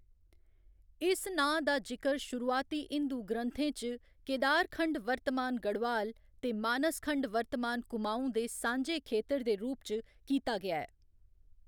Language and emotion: Dogri, neutral